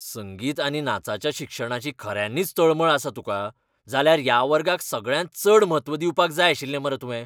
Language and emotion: Goan Konkani, angry